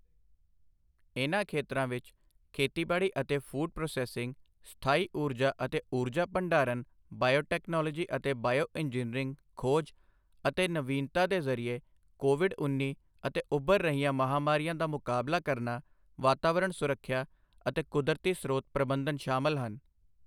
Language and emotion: Punjabi, neutral